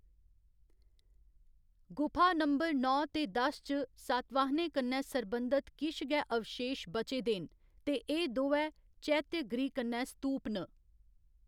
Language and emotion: Dogri, neutral